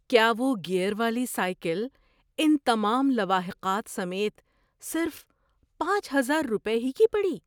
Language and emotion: Urdu, surprised